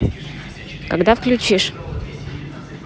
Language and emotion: Russian, neutral